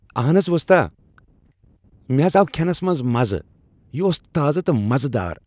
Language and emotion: Kashmiri, happy